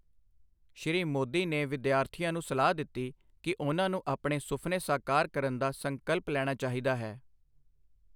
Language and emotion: Punjabi, neutral